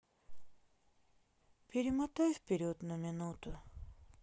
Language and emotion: Russian, sad